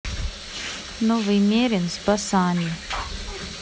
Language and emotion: Russian, neutral